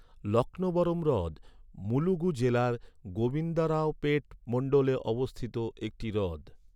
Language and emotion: Bengali, neutral